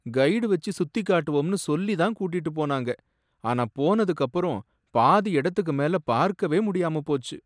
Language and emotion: Tamil, sad